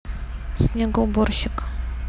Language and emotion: Russian, neutral